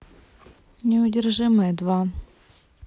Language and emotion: Russian, neutral